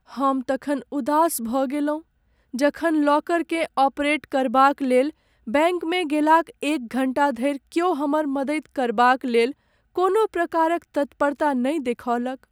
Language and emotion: Maithili, sad